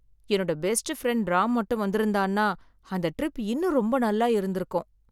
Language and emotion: Tamil, sad